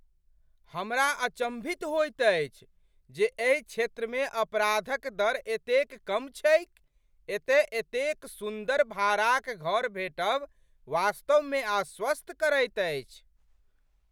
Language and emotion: Maithili, surprised